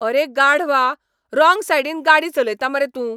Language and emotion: Goan Konkani, angry